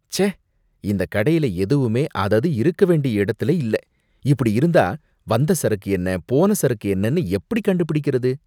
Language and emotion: Tamil, disgusted